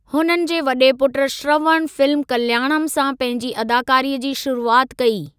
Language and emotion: Sindhi, neutral